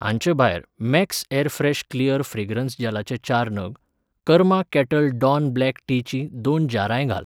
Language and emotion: Goan Konkani, neutral